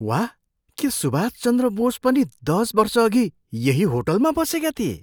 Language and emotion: Nepali, surprised